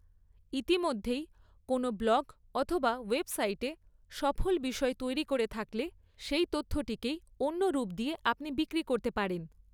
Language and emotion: Bengali, neutral